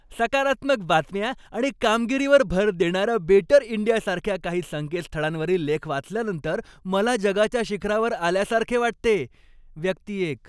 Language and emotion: Marathi, happy